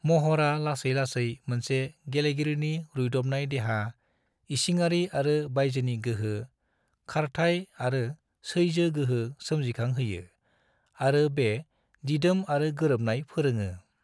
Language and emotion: Bodo, neutral